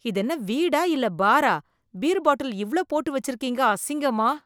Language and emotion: Tamil, disgusted